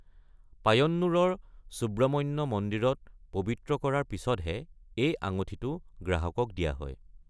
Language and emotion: Assamese, neutral